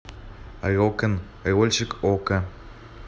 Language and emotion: Russian, neutral